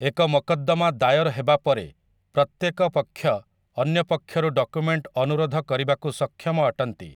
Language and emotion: Odia, neutral